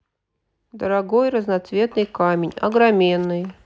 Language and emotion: Russian, neutral